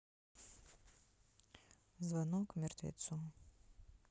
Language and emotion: Russian, neutral